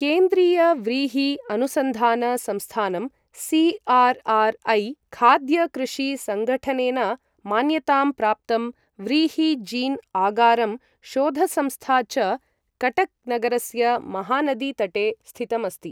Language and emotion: Sanskrit, neutral